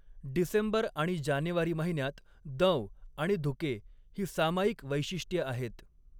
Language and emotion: Marathi, neutral